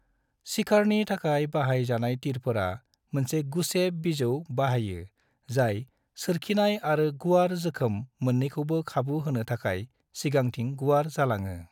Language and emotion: Bodo, neutral